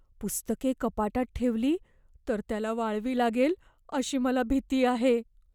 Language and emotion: Marathi, fearful